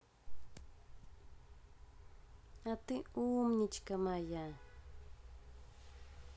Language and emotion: Russian, positive